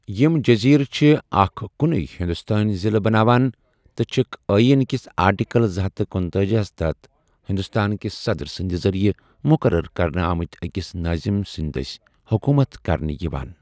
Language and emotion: Kashmiri, neutral